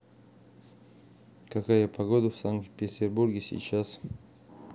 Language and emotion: Russian, neutral